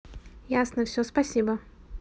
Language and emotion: Russian, neutral